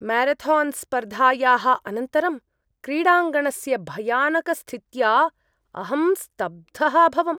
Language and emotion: Sanskrit, disgusted